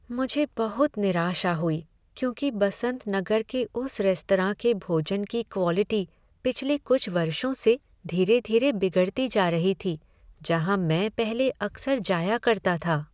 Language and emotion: Hindi, sad